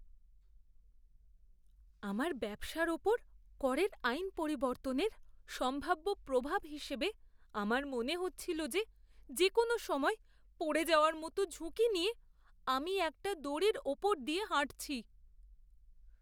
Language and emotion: Bengali, fearful